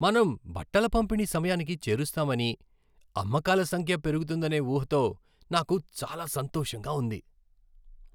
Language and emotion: Telugu, happy